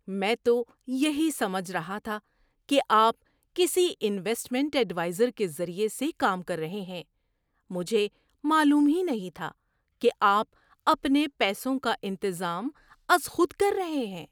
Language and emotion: Urdu, surprised